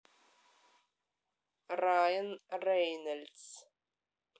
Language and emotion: Russian, neutral